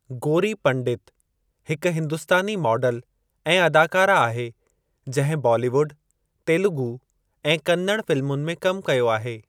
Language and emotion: Sindhi, neutral